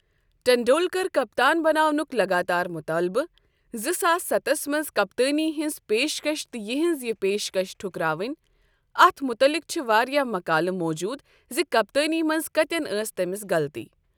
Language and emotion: Kashmiri, neutral